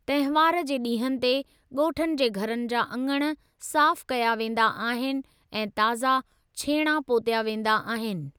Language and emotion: Sindhi, neutral